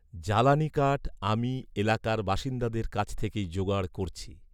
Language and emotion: Bengali, neutral